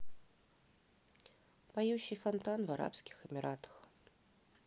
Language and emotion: Russian, neutral